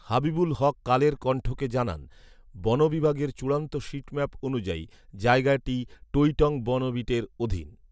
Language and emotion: Bengali, neutral